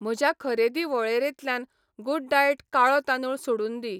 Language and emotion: Goan Konkani, neutral